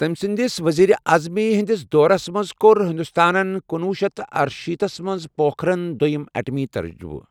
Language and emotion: Kashmiri, neutral